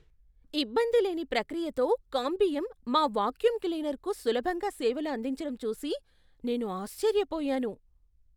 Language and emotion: Telugu, surprised